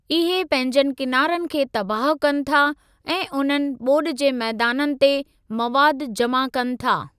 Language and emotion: Sindhi, neutral